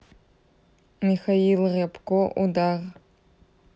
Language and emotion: Russian, neutral